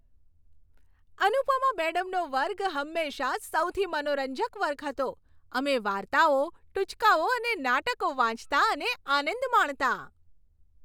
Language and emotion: Gujarati, happy